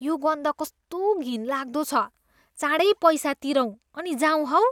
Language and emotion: Nepali, disgusted